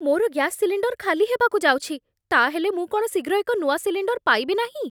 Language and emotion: Odia, fearful